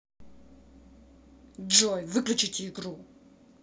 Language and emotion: Russian, angry